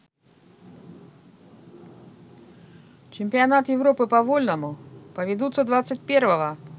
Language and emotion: Russian, neutral